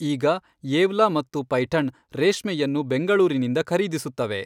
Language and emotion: Kannada, neutral